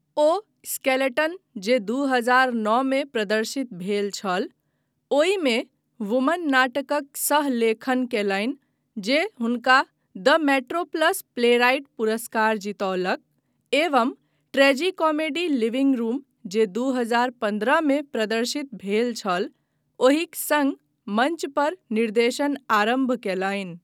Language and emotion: Maithili, neutral